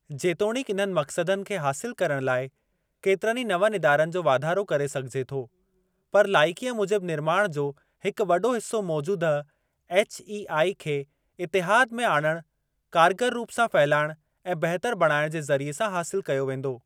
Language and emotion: Sindhi, neutral